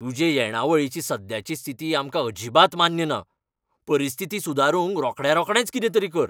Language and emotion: Goan Konkani, angry